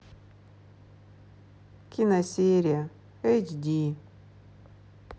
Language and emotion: Russian, sad